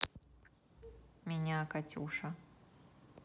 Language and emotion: Russian, neutral